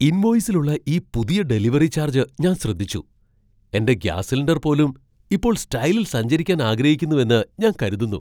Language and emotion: Malayalam, surprised